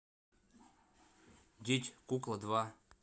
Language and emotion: Russian, neutral